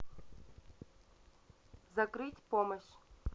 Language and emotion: Russian, neutral